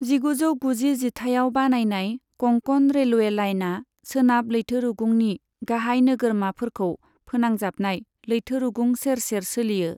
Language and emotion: Bodo, neutral